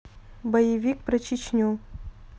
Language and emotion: Russian, neutral